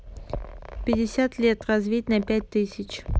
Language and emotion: Russian, neutral